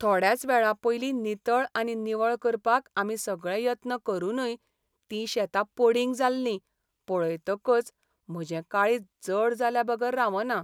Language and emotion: Goan Konkani, sad